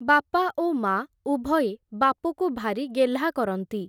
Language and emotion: Odia, neutral